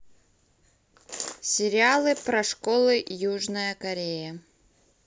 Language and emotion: Russian, neutral